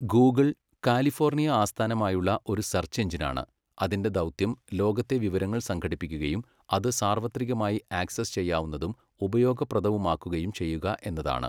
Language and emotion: Malayalam, neutral